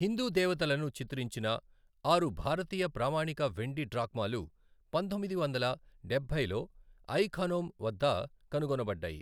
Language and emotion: Telugu, neutral